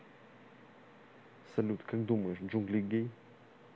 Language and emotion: Russian, neutral